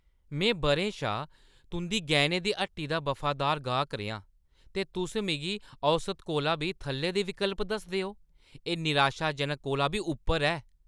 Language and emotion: Dogri, angry